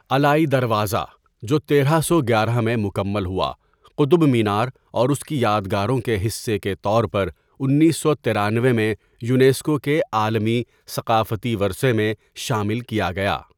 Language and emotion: Urdu, neutral